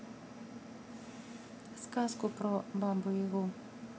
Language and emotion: Russian, neutral